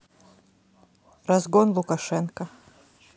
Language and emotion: Russian, neutral